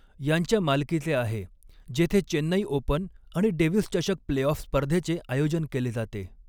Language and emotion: Marathi, neutral